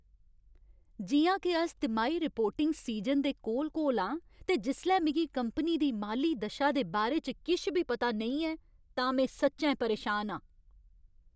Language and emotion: Dogri, angry